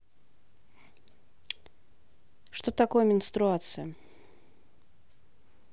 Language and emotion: Russian, neutral